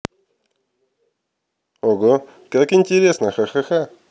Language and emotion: Russian, positive